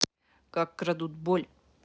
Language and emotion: Russian, neutral